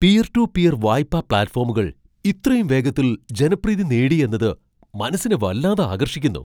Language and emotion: Malayalam, surprised